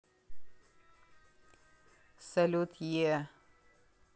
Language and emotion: Russian, neutral